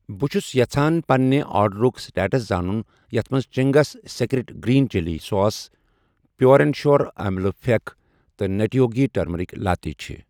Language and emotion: Kashmiri, neutral